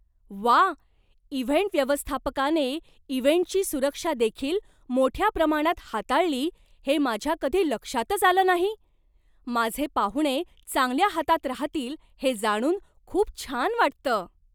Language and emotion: Marathi, surprised